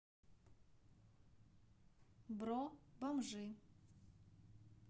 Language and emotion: Russian, neutral